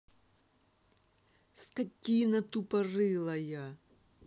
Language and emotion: Russian, angry